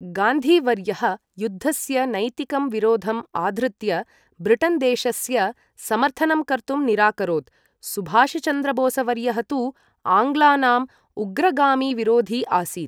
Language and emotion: Sanskrit, neutral